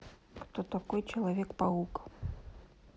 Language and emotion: Russian, neutral